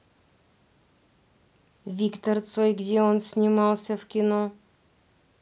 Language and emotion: Russian, neutral